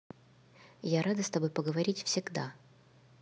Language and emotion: Russian, neutral